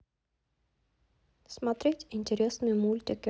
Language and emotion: Russian, neutral